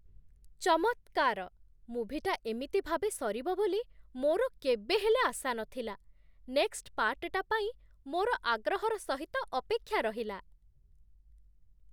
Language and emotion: Odia, surprised